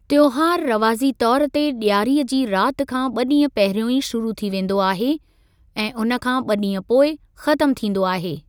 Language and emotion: Sindhi, neutral